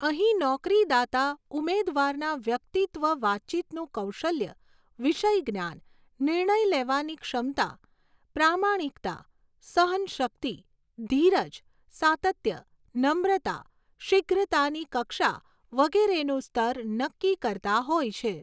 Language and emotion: Gujarati, neutral